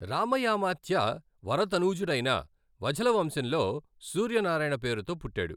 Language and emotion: Telugu, neutral